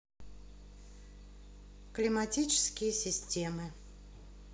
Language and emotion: Russian, neutral